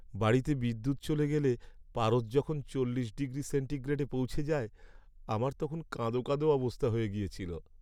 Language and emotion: Bengali, sad